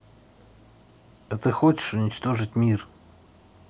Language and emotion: Russian, neutral